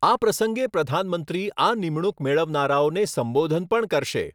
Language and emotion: Gujarati, neutral